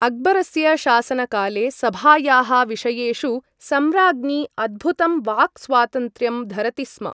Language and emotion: Sanskrit, neutral